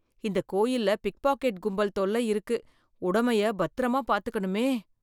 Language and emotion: Tamil, fearful